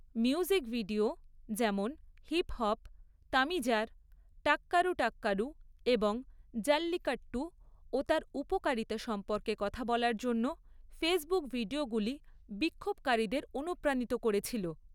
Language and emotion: Bengali, neutral